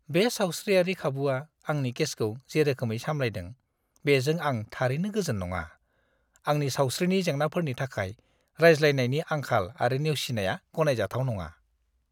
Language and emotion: Bodo, disgusted